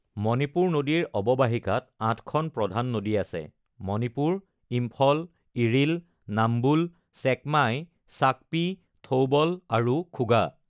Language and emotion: Assamese, neutral